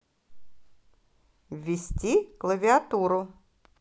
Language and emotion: Russian, positive